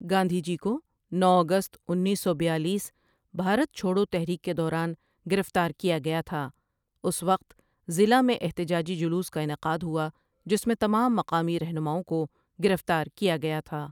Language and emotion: Urdu, neutral